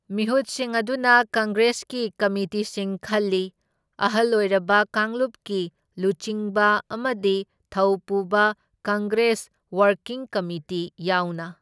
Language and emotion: Manipuri, neutral